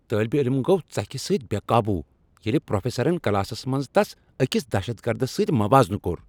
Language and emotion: Kashmiri, angry